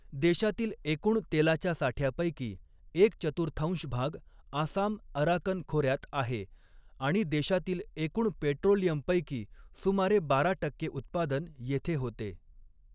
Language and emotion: Marathi, neutral